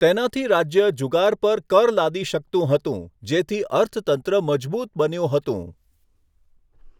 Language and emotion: Gujarati, neutral